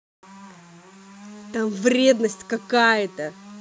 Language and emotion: Russian, angry